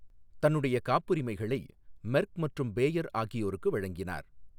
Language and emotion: Tamil, neutral